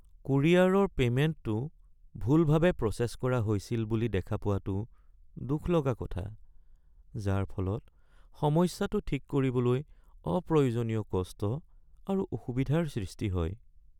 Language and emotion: Assamese, sad